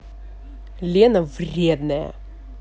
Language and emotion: Russian, angry